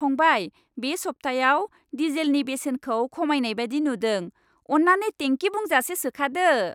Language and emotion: Bodo, happy